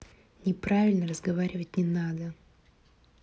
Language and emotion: Russian, neutral